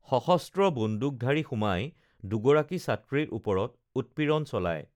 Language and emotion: Assamese, neutral